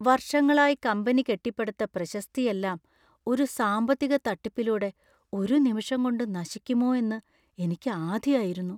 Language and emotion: Malayalam, fearful